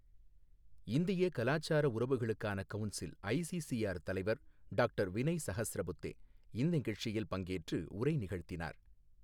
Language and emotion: Tamil, neutral